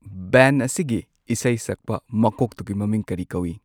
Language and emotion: Manipuri, neutral